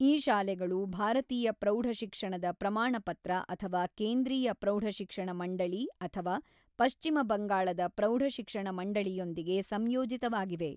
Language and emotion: Kannada, neutral